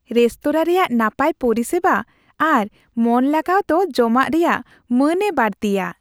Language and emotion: Santali, happy